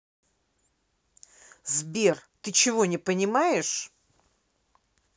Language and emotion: Russian, angry